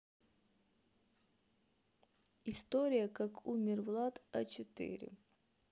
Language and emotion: Russian, neutral